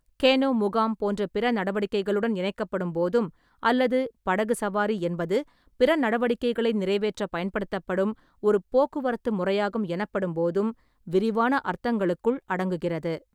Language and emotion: Tamil, neutral